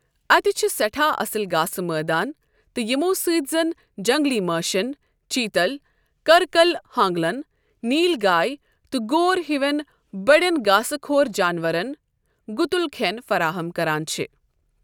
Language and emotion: Kashmiri, neutral